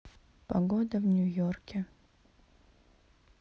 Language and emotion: Russian, neutral